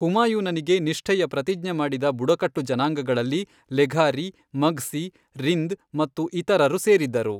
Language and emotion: Kannada, neutral